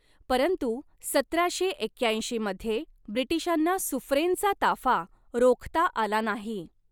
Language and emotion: Marathi, neutral